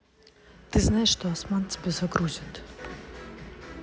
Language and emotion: Russian, neutral